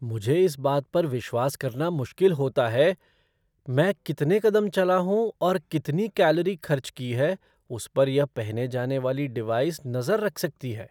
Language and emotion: Hindi, surprised